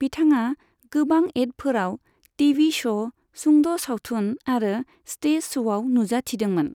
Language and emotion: Bodo, neutral